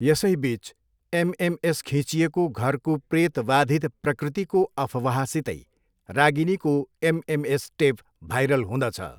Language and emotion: Nepali, neutral